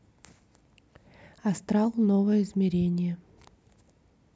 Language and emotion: Russian, neutral